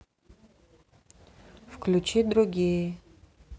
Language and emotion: Russian, neutral